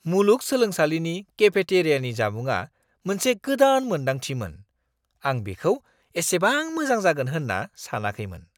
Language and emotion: Bodo, surprised